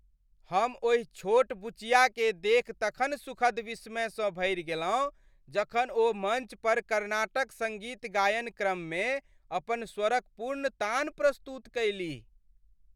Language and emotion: Maithili, happy